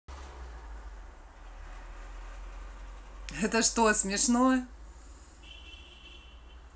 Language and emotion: Russian, positive